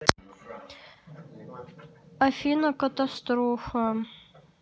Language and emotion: Russian, sad